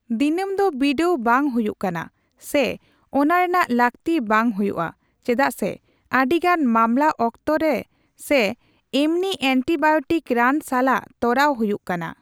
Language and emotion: Santali, neutral